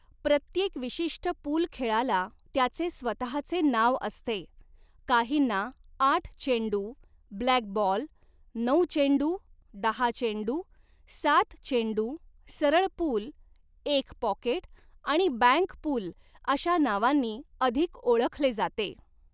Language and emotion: Marathi, neutral